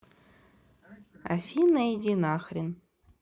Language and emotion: Russian, neutral